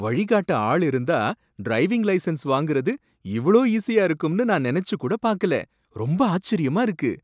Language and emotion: Tamil, surprised